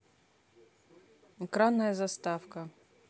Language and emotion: Russian, neutral